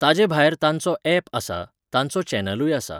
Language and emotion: Goan Konkani, neutral